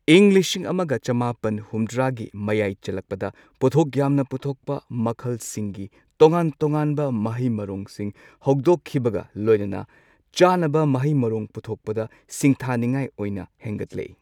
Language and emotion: Manipuri, neutral